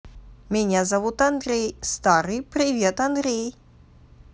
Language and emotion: Russian, positive